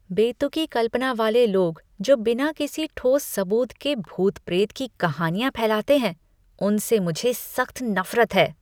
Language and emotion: Hindi, disgusted